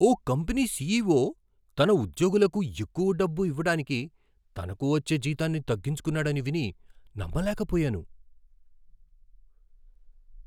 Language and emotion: Telugu, surprised